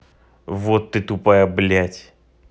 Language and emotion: Russian, angry